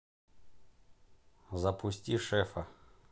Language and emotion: Russian, neutral